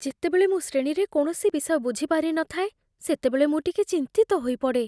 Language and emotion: Odia, fearful